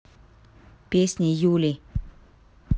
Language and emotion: Russian, neutral